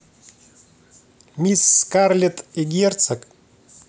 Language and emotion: Russian, positive